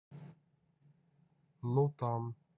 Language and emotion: Russian, neutral